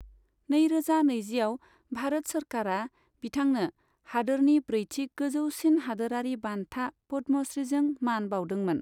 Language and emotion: Bodo, neutral